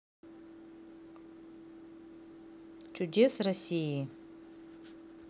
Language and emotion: Russian, neutral